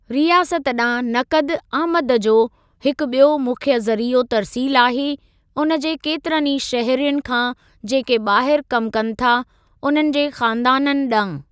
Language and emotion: Sindhi, neutral